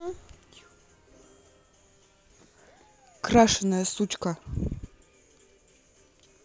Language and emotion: Russian, angry